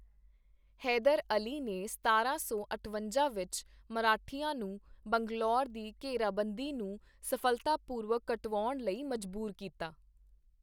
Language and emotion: Punjabi, neutral